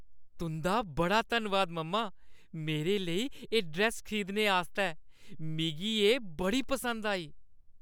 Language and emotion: Dogri, happy